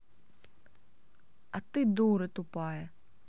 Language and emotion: Russian, angry